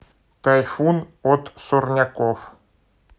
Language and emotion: Russian, neutral